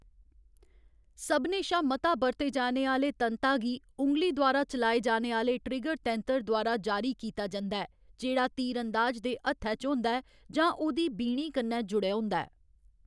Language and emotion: Dogri, neutral